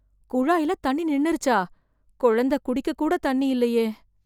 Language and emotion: Tamil, fearful